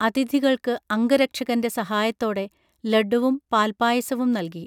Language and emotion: Malayalam, neutral